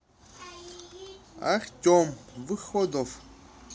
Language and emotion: Russian, neutral